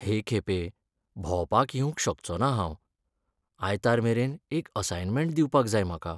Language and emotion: Goan Konkani, sad